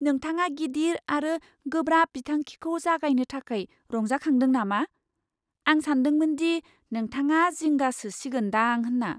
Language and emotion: Bodo, surprised